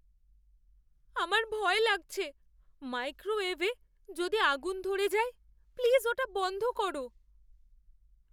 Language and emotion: Bengali, fearful